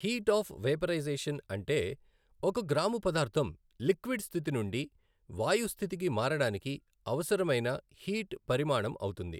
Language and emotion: Telugu, neutral